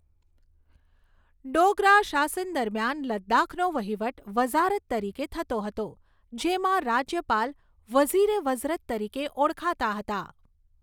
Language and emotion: Gujarati, neutral